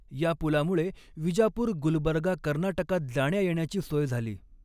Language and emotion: Marathi, neutral